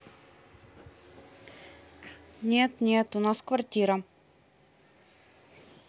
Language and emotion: Russian, neutral